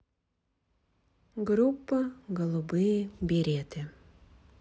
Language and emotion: Russian, neutral